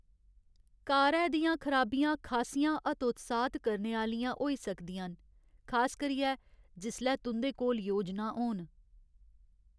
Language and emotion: Dogri, sad